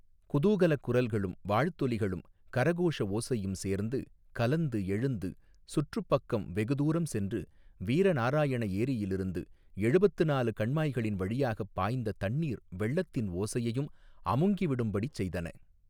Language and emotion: Tamil, neutral